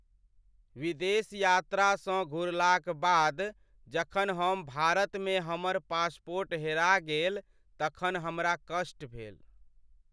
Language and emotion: Maithili, sad